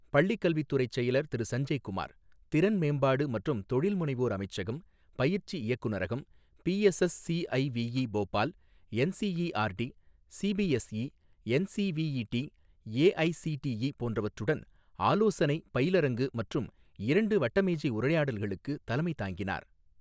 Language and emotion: Tamil, neutral